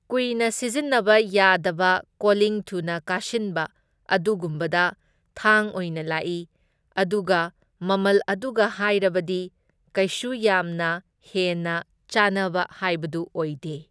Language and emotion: Manipuri, neutral